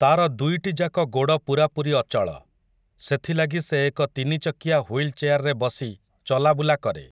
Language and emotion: Odia, neutral